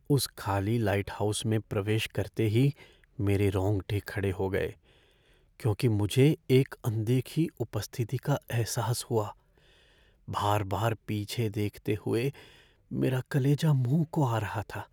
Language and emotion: Hindi, fearful